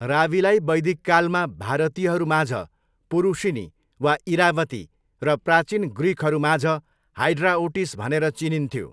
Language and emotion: Nepali, neutral